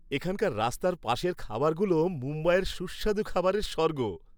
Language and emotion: Bengali, happy